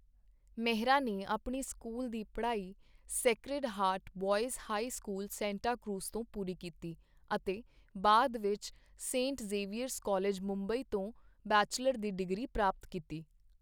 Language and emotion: Punjabi, neutral